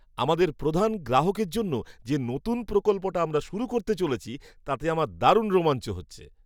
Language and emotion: Bengali, happy